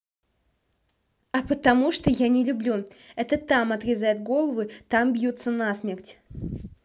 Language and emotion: Russian, neutral